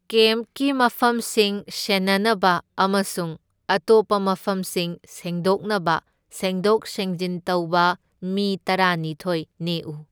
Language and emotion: Manipuri, neutral